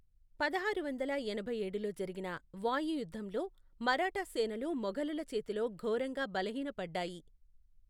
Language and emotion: Telugu, neutral